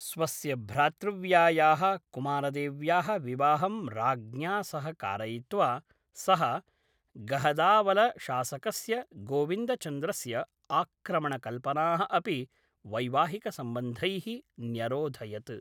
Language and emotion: Sanskrit, neutral